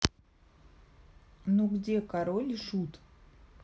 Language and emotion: Russian, neutral